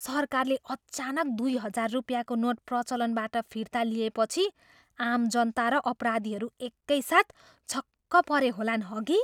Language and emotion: Nepali, surprised